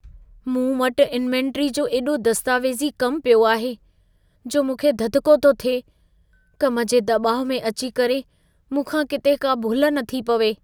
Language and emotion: Sindhi, fearful